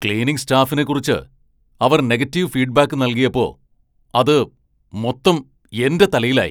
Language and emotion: Malayalam, angry